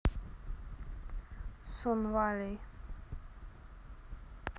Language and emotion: Russian, neutral